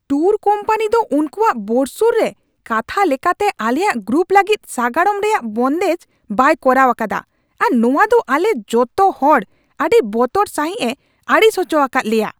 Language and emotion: Santali, angry